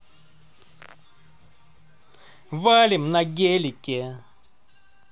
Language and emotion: Russian, positive